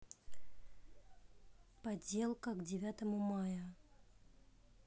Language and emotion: Russian, neutral